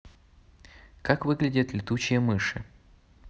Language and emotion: Russian, neutral